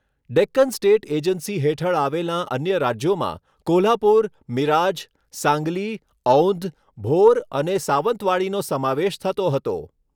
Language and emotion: Gujarati, neutral